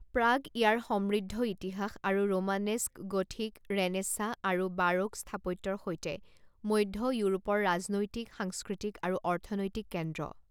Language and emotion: Assamese, neutral